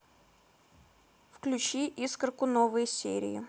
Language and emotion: Russian, neutral